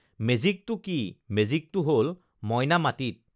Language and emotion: Assamese, neutral